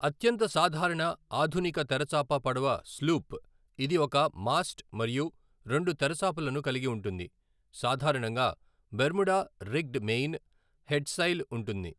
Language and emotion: Telugu, neutral